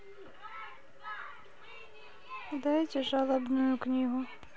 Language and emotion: Russian, sad